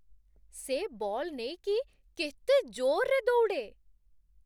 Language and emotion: Odia, surprised